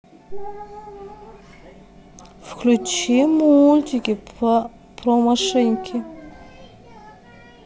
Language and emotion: Russian, sad